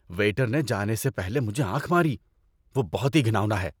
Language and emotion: Urdu, disgusted